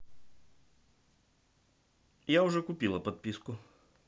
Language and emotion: Russian, neutral